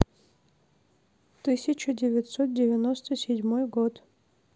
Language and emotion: Russian, neutral